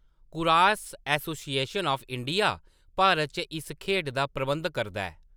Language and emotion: Dogri, neutral